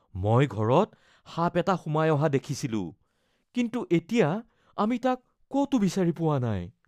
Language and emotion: Assamese, fearful